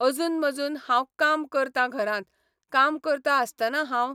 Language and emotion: Goan Konkani, neutral